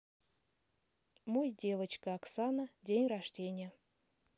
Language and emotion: Russian, neutral